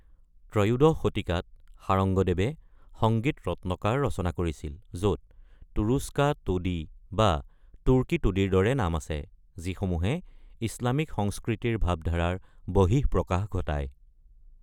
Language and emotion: Assamese, neutral